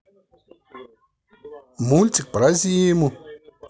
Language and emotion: Russian, positive